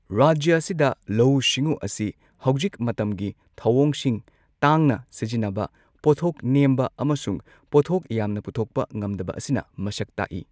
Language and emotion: Manipuri, neutral